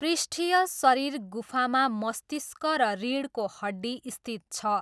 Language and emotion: Nepali, neutral